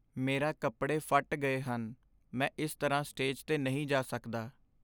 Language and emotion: Punjabi, sad